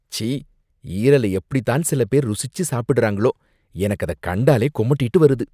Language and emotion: Tamil, disgusted